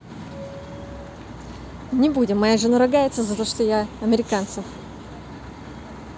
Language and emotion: Russian, neutral